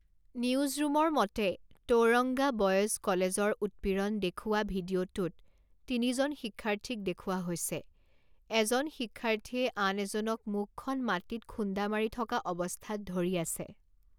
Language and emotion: Assamese, neutral